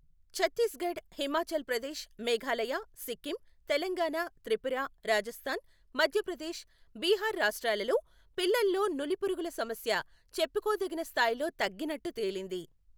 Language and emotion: Telugu, neutral